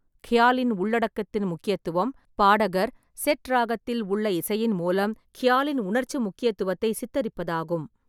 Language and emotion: Tamil, neutral